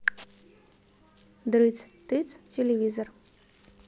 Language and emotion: Russian, neutral